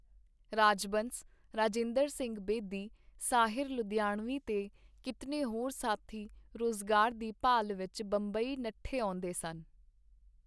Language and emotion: Punjabi, neutral